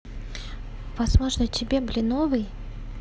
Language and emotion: Russian, neutral